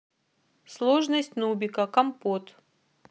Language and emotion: Russian, neutral